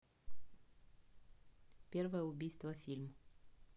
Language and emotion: Russian, neutral